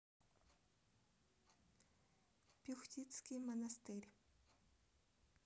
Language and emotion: Russian, neutral